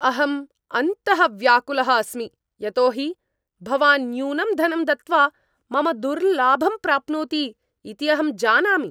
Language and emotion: Sanskrit, angry